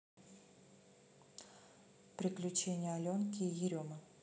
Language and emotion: Russian, neutral